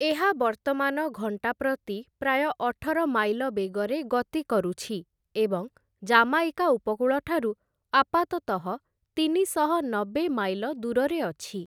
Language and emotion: Odia, neutral